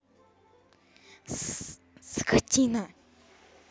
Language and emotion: Russian, angry